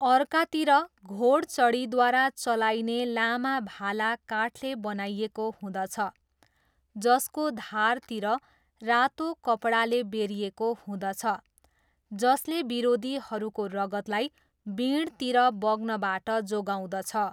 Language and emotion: Nepali, neutral